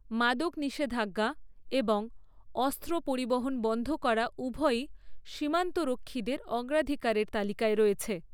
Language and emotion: Bengali, neutral